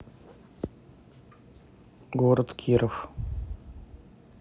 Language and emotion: Russian, neutral